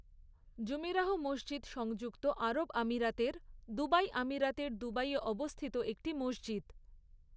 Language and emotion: Bengali, neutral